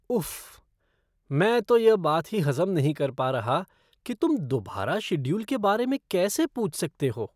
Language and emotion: Hindi, disgusted